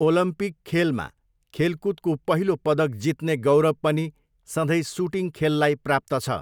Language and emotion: Nepali, neutral